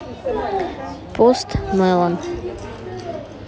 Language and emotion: Russian, neutral